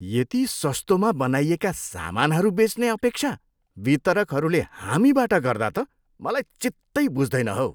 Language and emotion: Nepali, disgusted